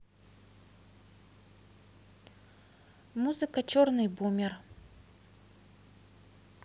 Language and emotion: Russian, neutral